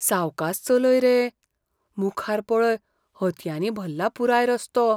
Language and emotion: Goan Konkani, fearful